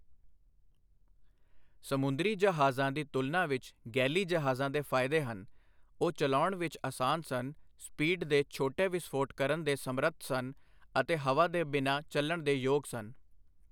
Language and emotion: Punjabi, neutral